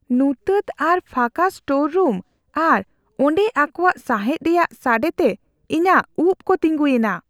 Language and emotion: Santali, fearful